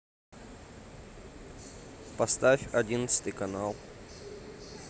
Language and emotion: Russian, neutral